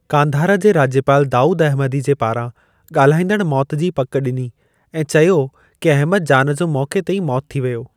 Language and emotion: Sindhi, neutral